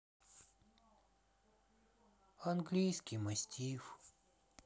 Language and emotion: Russian, sad